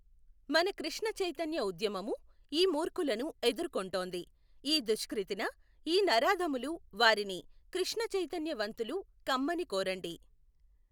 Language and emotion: Telugu, neutral